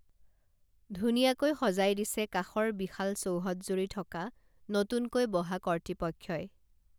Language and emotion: Assamese, neutral